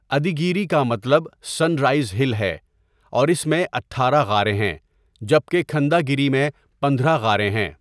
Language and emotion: Urdu, neutral